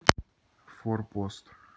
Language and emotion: Russian, neutral